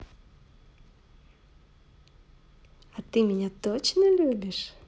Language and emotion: Russian, positive